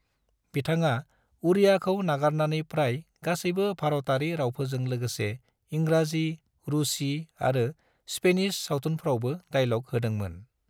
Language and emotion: Bodo, neutral